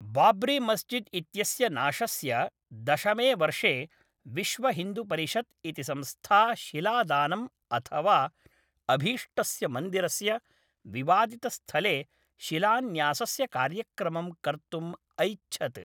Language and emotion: Sanskrit, neutral